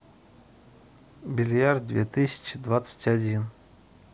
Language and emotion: Russian, neutral